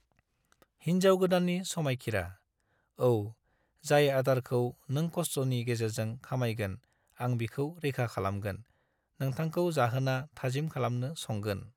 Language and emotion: Bodo, neutral